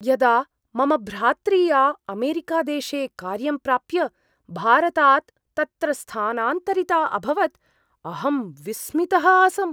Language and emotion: Sanskrit, surprised